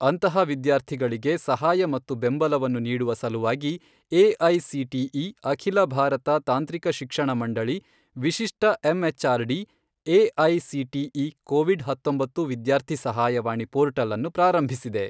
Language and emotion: Kannada, neutral